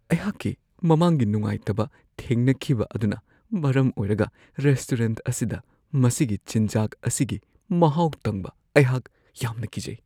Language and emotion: Manipuri, fearful